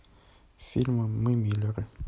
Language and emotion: Russian, neutral